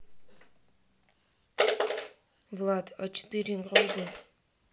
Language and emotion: Russian, neutral